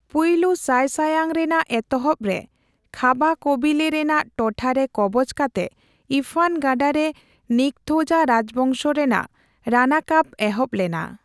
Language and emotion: Santali, neutral